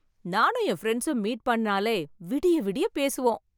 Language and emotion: Tamil, happy